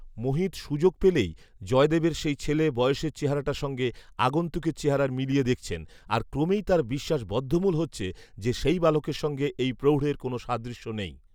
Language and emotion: Bengali, neutral